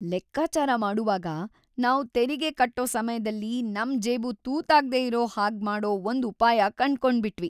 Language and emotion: Kannada, happy